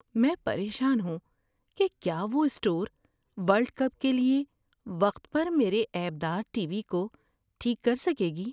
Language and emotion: Urdu, fearful